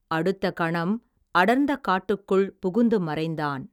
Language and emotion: Tamil, neutral